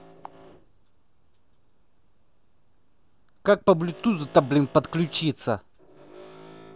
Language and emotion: Russian, angry